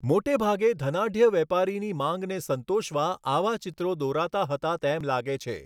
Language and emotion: Gujarati, neutral